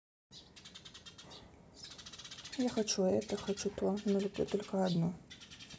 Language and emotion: Russian, neutral